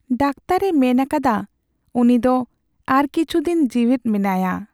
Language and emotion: Santali, sad